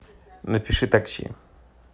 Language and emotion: Russian, neutral